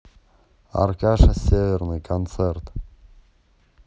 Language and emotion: Russian, neutral